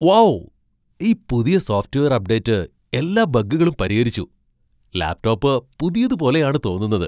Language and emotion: Malayalam, surprised